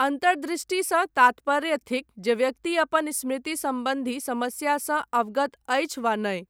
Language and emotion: Maithili, neutral